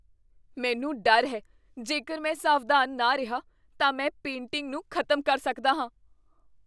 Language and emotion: Punjabi, fearful